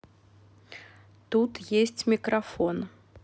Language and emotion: Russian, neutral